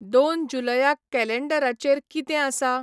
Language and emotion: Goan Konkani, neutral